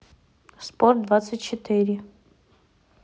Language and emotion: Russian, neutral